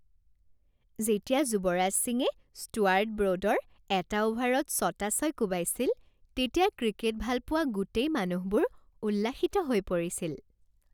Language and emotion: Assamese, happy